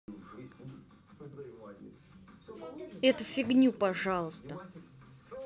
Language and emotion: Russian, angry